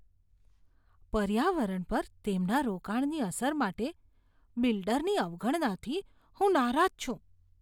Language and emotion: Gujarati, disgusted